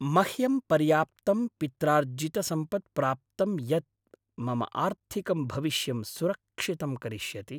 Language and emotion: Sanskrit, happy